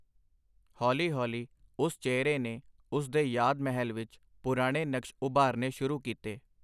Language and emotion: Punjabi, neutral